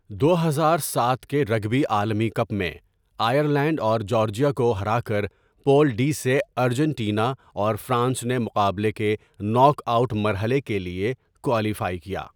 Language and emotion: Urdu, neutral